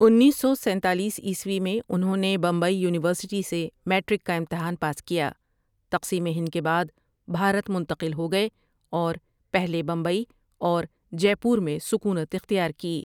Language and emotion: Urdu, neutral